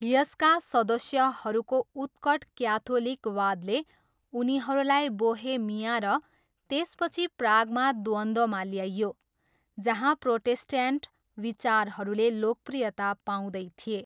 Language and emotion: Nepali, neutral